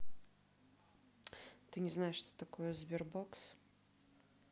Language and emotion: Russian, neutral